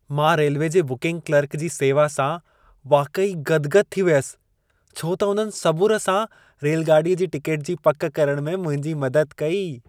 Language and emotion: Sindhi, happy